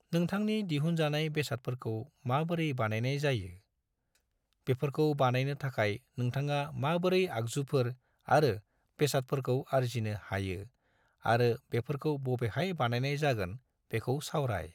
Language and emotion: Bodo, neutral